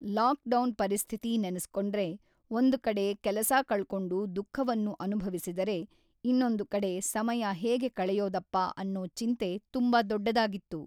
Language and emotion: Kannada, neutral